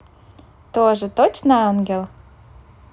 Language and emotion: Russian, positive